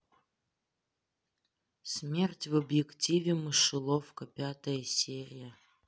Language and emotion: Russian, neutral